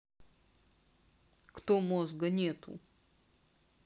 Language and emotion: Russian, neutral